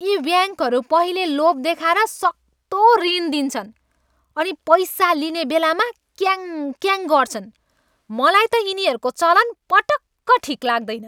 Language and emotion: Nepali, angry